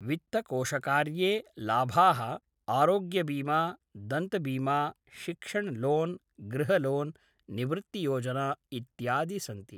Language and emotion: Sanskrit, neutral